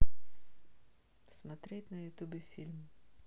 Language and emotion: Russian, neutral